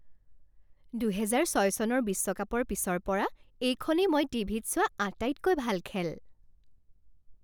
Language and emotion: Assamese, happy